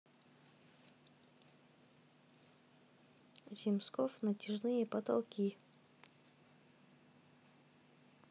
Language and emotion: Russian, neutral